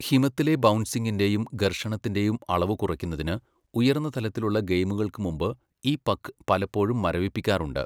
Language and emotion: Malayalam, neutral